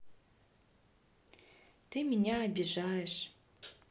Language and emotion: Russian, sad